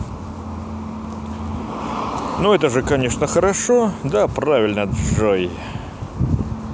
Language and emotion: Russian, positive